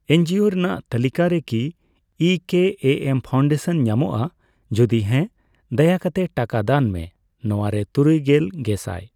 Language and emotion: Santali, neutral